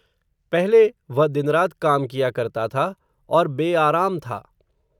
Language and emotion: Hindi, neutral